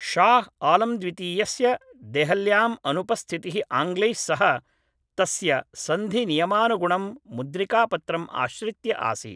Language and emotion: Sanskrit, neutral